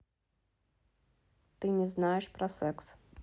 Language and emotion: Russian, neutral